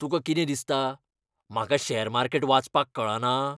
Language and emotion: Goan Konkani, angry